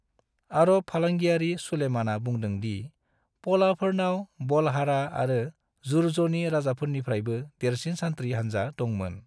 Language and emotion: Bodo, neutral